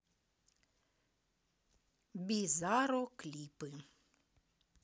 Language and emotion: Russian, neutral